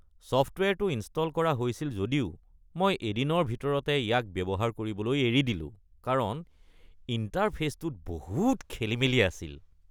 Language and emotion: Assamese, disgusted